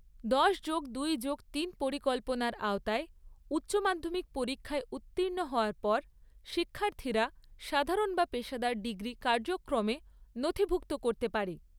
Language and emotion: Bengali, neutral